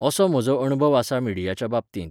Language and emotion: Goan Konkani, neutral